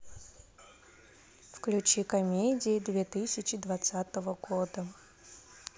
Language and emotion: Russian, neutral